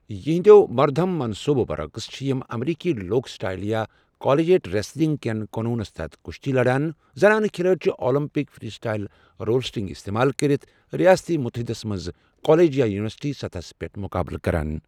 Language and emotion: Kashmiri, neutral